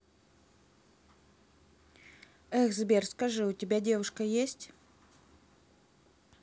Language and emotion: Russian, neutral